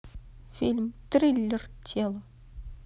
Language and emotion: Russian, neutral